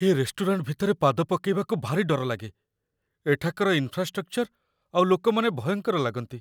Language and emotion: Odia, fearful